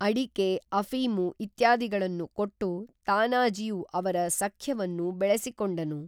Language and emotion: Kannada, neutral